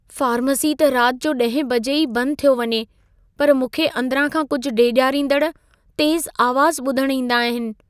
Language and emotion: Sindhi, fearful